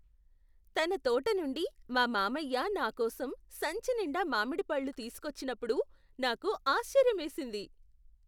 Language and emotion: Telugu, surprised